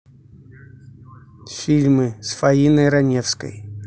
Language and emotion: Russian, neutral